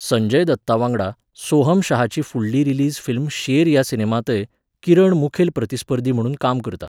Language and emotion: Goan Konkani, neutral